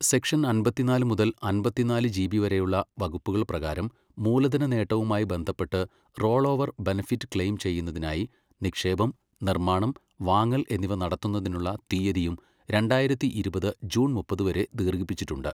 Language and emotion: Malayalam, neutral